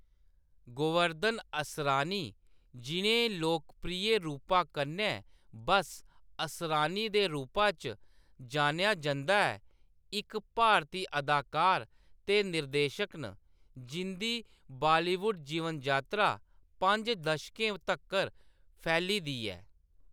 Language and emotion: Dogri, neutral